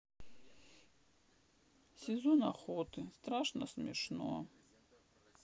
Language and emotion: Russian, sad